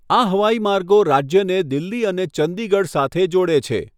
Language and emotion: Gujarati, neutral